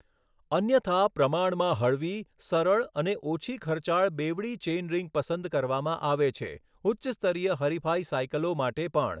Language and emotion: Gujarati, neutral